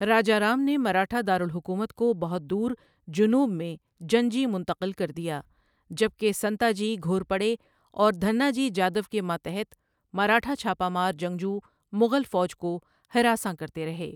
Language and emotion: Urdu, neutral